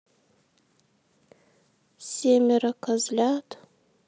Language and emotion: Russian, sad